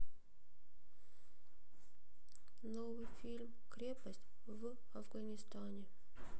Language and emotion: Russian, sad